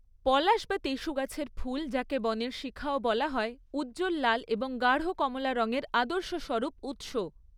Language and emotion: Bengali, neutral